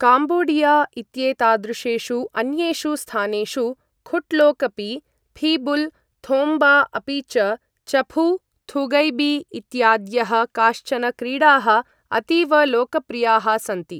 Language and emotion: Sanskrit, neutral